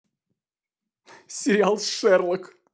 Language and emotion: Russian, positive